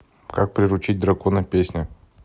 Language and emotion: Russian, neutral